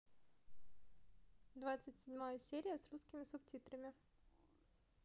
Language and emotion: Russian, neutral